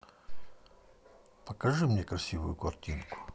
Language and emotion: Russian, neutral